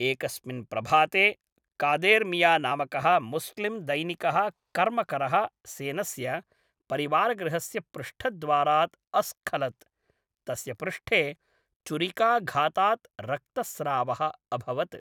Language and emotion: Sanskrit, neutral